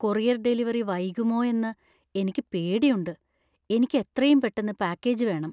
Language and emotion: Malayalam, fearful